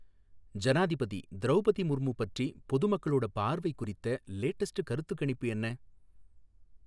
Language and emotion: Tamil, neutral